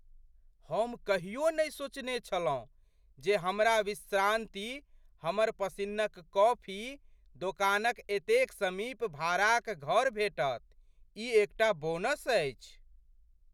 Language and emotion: Maithili, surprised